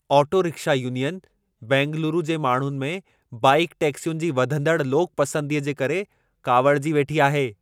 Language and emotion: Sindhi, angry